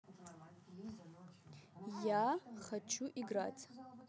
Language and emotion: Russian, neutral